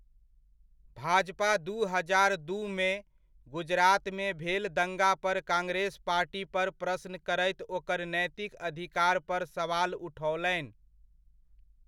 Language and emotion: Maithili, neutral